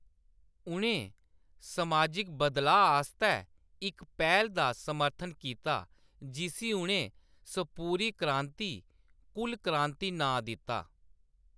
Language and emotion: Dogri, neutral